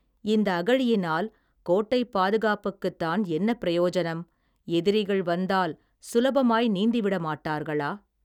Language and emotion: Tamil, neutral